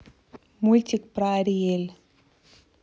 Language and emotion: Russian, neutral